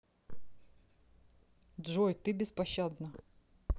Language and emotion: Russian, neutral